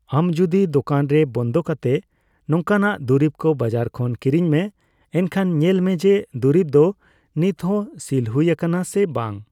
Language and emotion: Santali, neutral